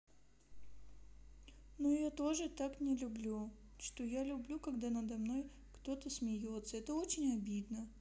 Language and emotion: Russian, sad